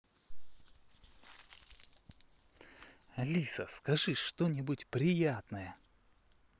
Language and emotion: Russian, positive